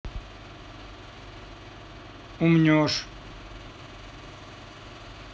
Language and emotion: Russian, neutral